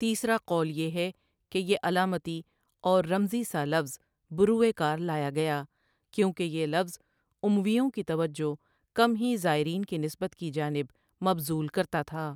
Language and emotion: Urdu, neutral